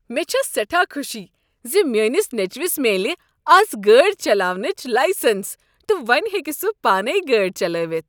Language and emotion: Kashmiri, happy